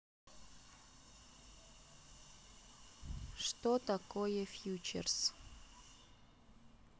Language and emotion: Russian, neutral